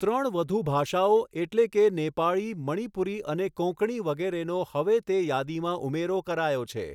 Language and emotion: Gujarati, neutral